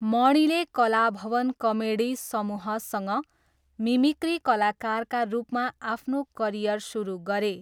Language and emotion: Nepali, neutral